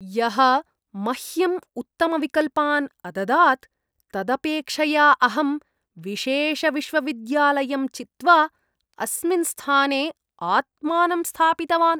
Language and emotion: Sanskrit, disgusted